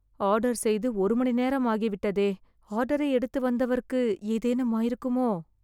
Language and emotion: Tamil, fearful